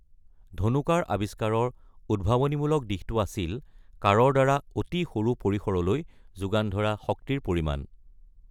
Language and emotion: Assamese, neutral